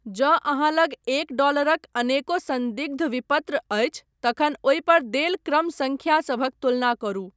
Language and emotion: Maithili, neutral